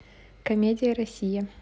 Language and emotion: Russian, neutral